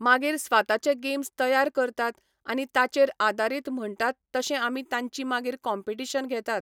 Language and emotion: Goan Konkani, neutral